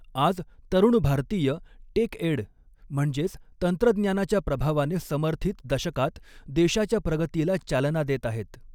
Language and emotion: Marathi, neutral